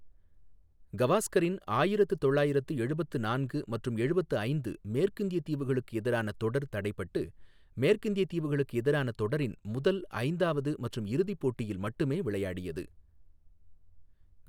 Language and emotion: Tamil, neutral